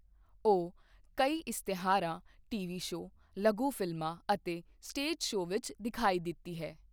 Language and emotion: Punjabi, neutral